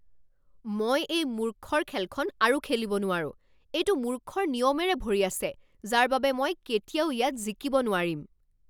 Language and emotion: Assamese, angry